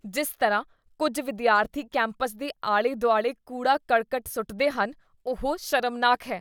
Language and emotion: Punjabi, disgusted